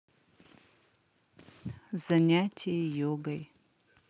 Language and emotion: Russian, sad